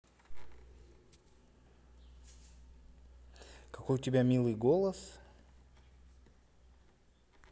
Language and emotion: Russian, positive